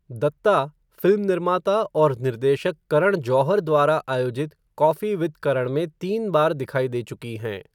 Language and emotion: Hindi, neutral